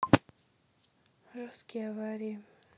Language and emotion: Russian, neutral